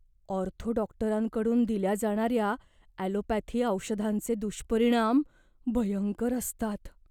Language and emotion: Marathi, fearful